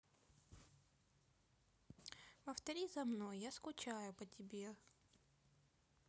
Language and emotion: Russian, sad